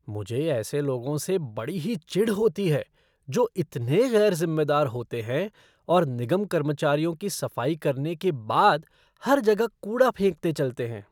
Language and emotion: Hindi, disgusted